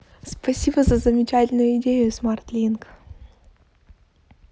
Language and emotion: Russian, positive